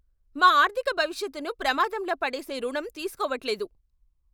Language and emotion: Telugu, angry